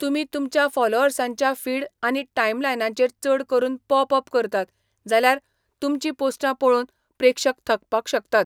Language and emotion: Goan Konkani, neutral